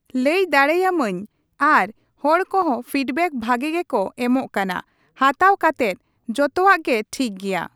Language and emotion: Santali, neutral